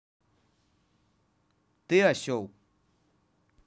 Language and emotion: Russian, neutral